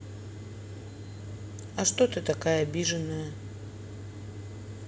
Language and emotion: Russian, neutral